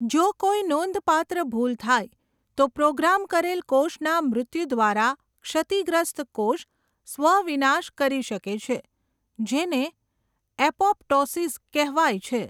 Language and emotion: Gujarati, neutral